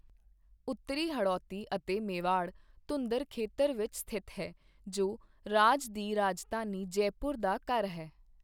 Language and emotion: Punjabi, neutral